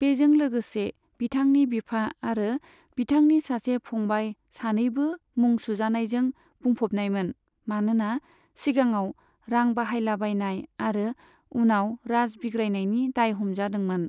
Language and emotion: Bodo, neutral